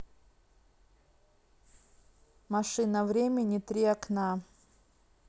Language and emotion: Russian, neutral